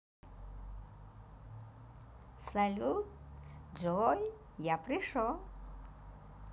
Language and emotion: Russian, positive